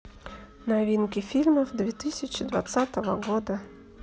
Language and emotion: Russian, neutral